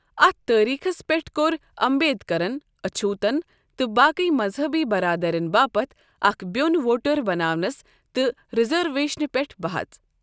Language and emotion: Kashmiri, neutral